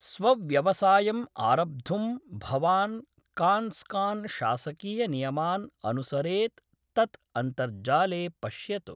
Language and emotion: Sanskrit, neutral